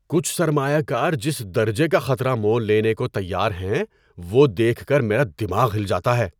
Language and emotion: Urdu, surprised